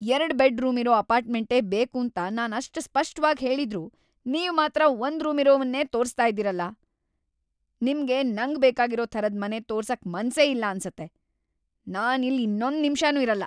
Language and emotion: Kannada, angry